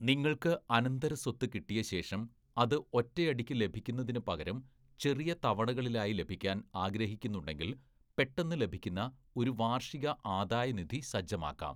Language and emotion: Malayalam, neutral